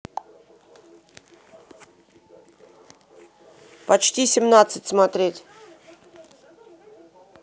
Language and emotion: Russian, neutral